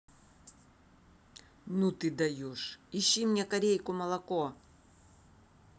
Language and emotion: Russian, angry